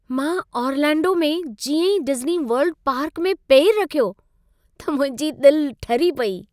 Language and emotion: Sindhi, happy